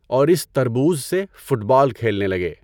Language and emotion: Urdu, neutral